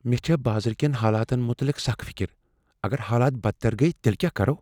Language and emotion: Kashmiri, fearful